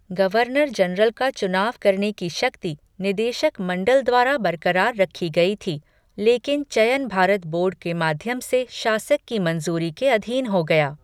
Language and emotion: Hindi, neutral